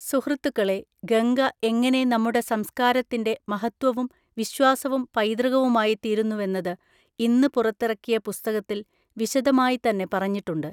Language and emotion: Malayalam, neutral